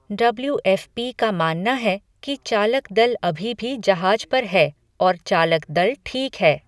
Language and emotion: Hindi, neutral